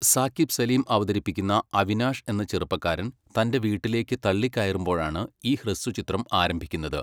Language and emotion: Malayalam, neutral